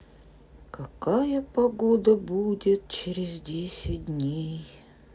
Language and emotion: Russian, sad